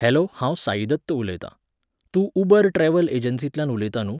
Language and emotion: Goan Konkani, neutral